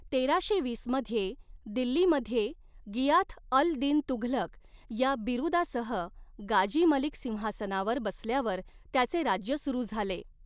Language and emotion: Marathi, neutral